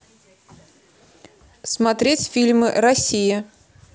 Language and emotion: Russian, neutral